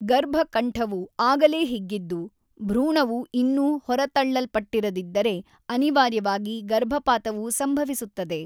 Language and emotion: Kannada, neutral